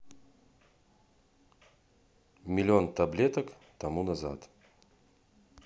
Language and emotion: Russian, neutral